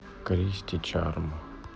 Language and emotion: Russian, neutral